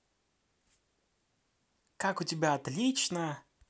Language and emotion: Russian, positive